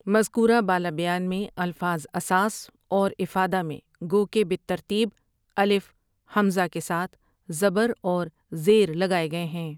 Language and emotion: Urdu, neutral